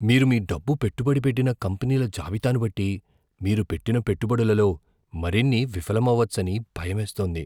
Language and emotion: Telugu, fearful